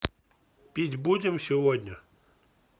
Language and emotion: Russian, neutral